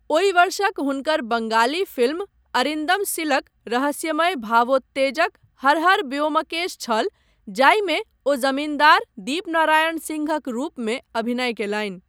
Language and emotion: Maithili, neutral